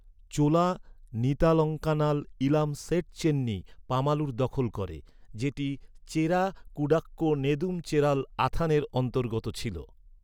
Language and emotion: Bengali, neutral